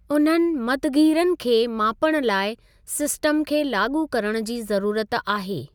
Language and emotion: Sindhi, neutral